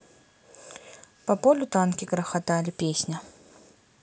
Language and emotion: Russian, neutral